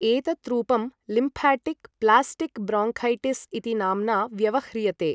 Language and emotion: Sanskrit, neutral